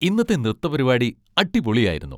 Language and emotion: Malayalam, happy